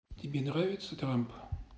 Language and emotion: Russian, neutral